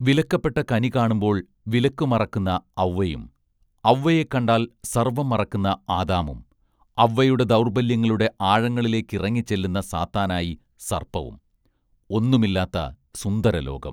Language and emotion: Malayalam, neutral